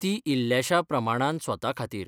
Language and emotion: Goan Konkani, neutral